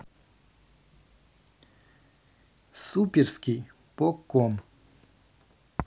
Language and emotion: Russian, neutral